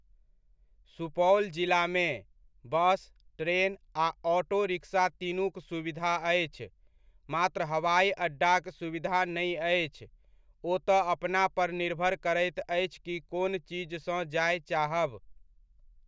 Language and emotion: Maithili, neutral